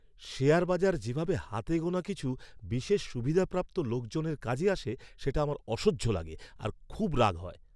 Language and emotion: Bengali, angry